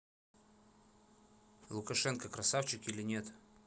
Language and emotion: Russian, neutral